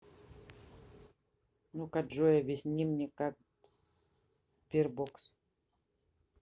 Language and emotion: Russian, neutral